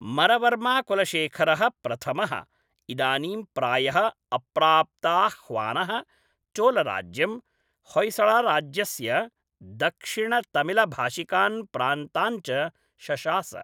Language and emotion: Sanskrit, neutral